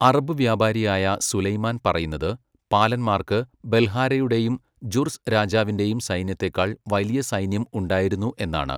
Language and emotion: Malayalam, neutral